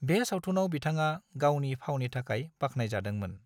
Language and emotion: Bodo, neutral